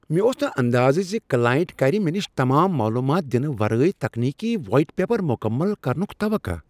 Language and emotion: Kashmiri, surprised